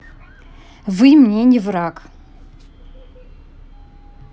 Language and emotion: Russian, angry